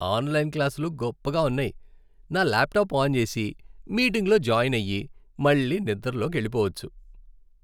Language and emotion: Telugu, happy